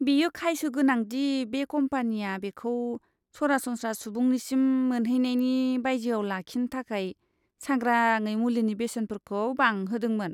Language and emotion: Bodo, disgusted